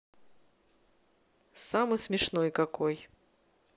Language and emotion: Russian, neutral